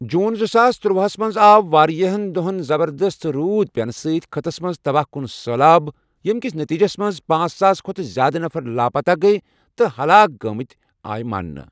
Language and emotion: Kashmiri, neutral